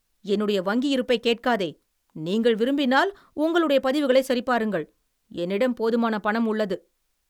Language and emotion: Tamil, angry